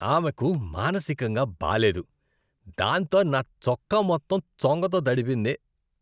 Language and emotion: Telugu, disgusted